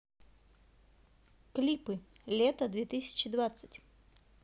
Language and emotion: Russian, neutral